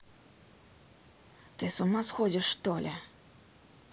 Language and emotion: Russian, angry